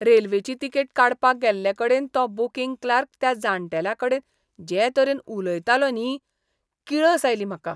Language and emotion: Goan Konkani, disgusted